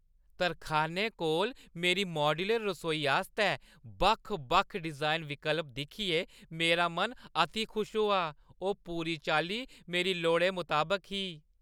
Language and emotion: Dogri, happy